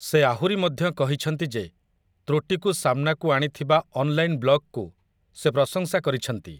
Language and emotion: Odia, neutral